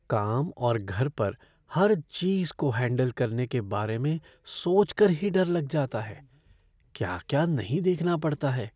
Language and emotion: Hindi, fearful